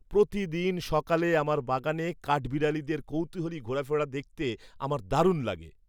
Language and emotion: Bengali, happy